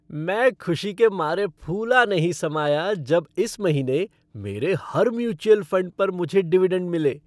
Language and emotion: Hindi, happy